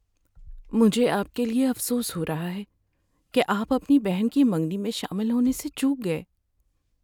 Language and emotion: Urdu, sad